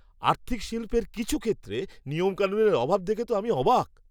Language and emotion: Bengali, surprised